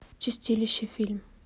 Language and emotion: Russian, neutral